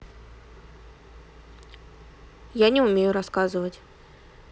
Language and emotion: Russian, neutral